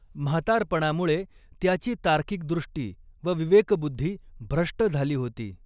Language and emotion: Marathi, neutral